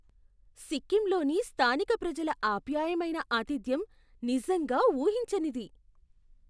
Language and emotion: Telugu, surprised